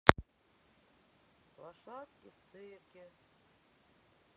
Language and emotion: Russian, sad